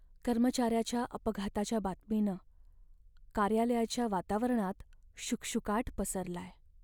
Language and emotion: Marathi, sad